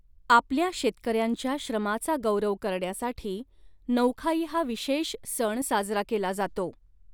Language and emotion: Marathi, neutral